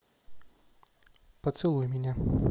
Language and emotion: Russian, neutral